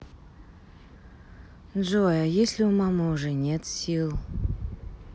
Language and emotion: Russian, sad